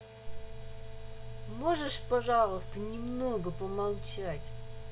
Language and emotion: Russian, angry